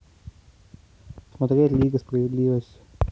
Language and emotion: Russian, neutral